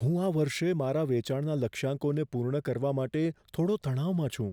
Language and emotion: Gujarati, fearful